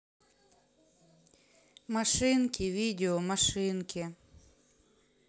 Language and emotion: Russian, sad